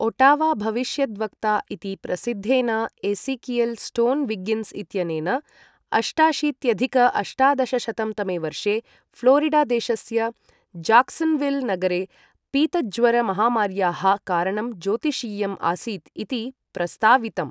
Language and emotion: Sanskrit, neutral